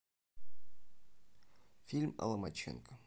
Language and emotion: Russian, neutral